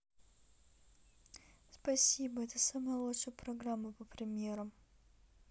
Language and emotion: Russian, sad